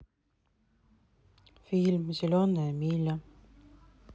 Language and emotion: Russian, neutral